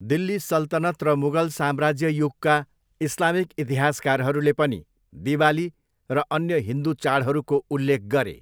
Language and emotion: Nepali, neutral